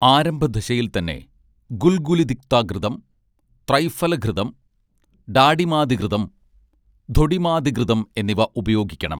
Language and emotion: Malayalam, neutral